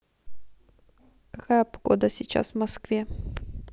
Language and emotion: Russian, neutral